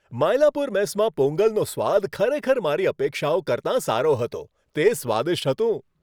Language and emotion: Gujarati, happy